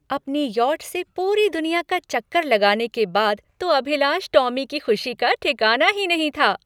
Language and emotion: Hindi, happy